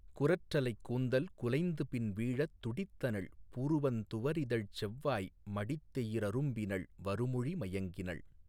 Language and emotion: Tamil, neutral